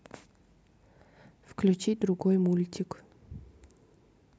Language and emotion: Russian, neutral